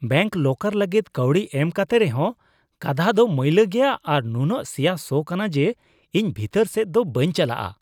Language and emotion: Santali, disgusted